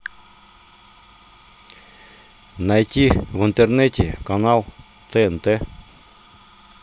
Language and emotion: Russian, neutral